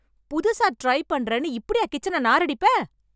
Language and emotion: Tamil, angry